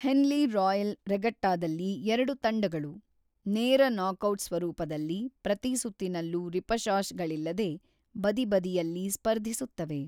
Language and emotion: Kannada, neutral